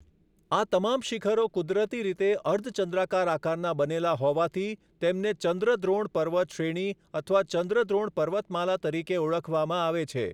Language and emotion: Gujarati, neutral